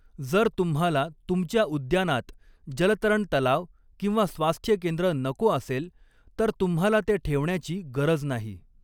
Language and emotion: Marathi, neutral